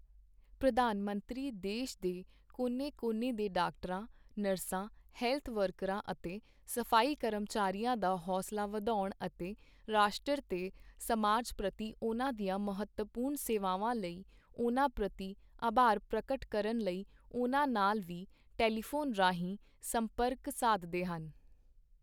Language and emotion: Punjabi, neutral